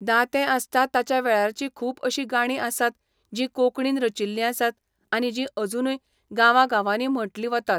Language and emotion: Goan Konkani, neutral